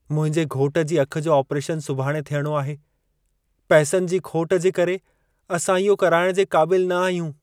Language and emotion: Sindhi, sad